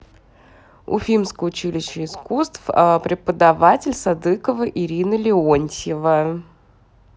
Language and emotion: Russian, neutral